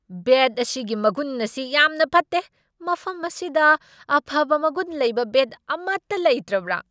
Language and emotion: Manipuri, angry